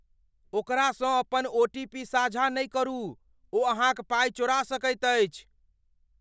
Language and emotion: Maithili, fearful